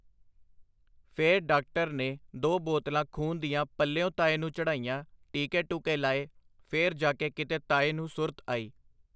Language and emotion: Punjabi, neutral